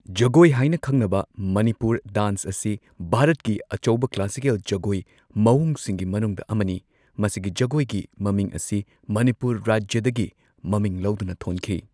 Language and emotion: Manipuri, neutral